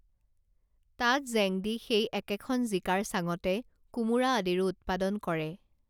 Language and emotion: Assamese, neutral